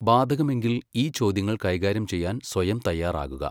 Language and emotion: Malayalam, neutral